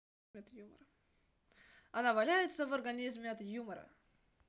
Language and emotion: Russian, neutral